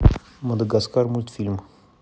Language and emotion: Russian, neutral